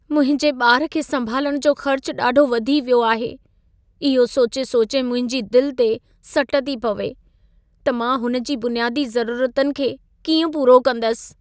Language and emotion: Sindhi, sad